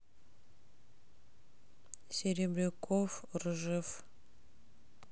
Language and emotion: Russian, neutral